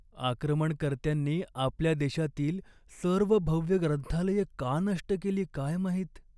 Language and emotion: Marathi, sad